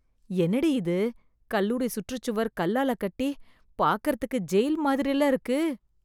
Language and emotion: Tamil, disgusted